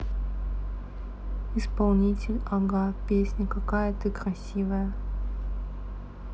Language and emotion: Russian, neutral